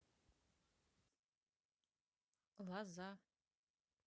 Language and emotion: Russian, neutral